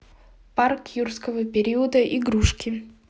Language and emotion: Russian, neutral